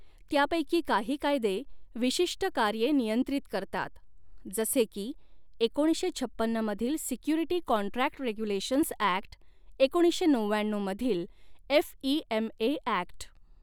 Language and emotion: Marathi, neutral